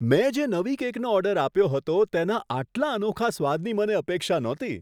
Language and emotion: Gujarati, surprised